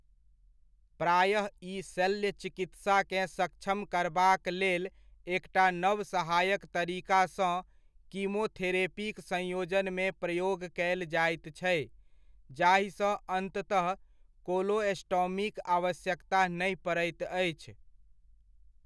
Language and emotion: Maithili, neutral